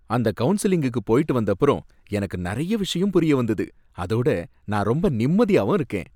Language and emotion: Tamil, happy